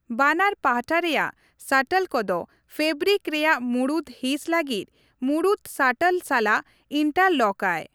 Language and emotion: Santali, neutral